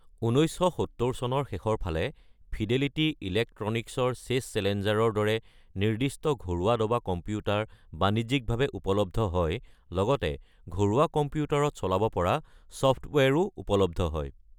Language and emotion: Assamese, neutral